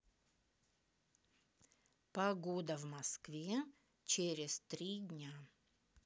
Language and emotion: Russian, neutral